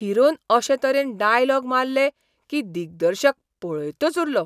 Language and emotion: Goan Konkani, surprised